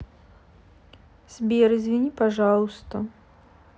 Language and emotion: Russian, sad